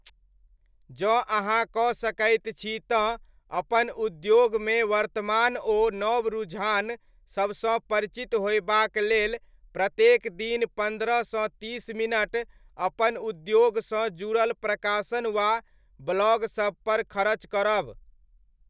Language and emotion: Maithili, neutral